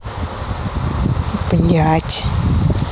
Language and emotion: Russian, angry